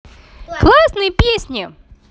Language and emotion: Russian, positive